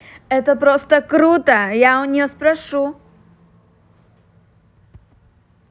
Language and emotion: Russian, positive